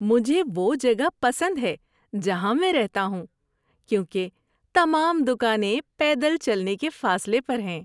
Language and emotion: Urdu, happy